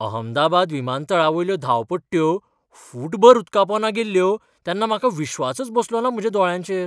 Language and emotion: Goan Konkani, surprised